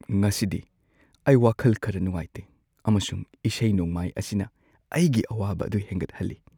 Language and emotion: Manipuri, sad